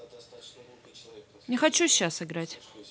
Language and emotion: Russian, angry